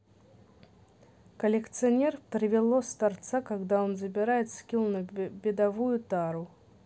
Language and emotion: Russian, neutral